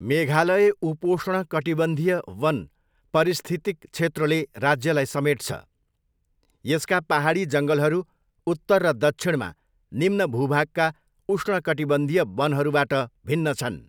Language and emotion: Nepali, neutral